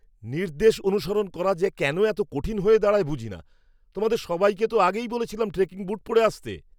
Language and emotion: Bengali, angry